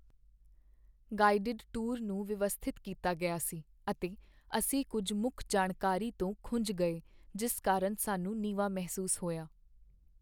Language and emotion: Punjabi, sad